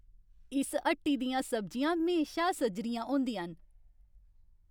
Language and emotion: Dogri, happy